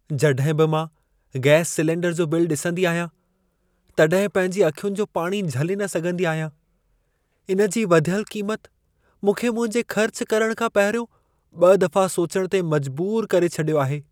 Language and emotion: Sindhi, sad